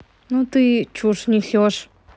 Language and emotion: Russian, neutral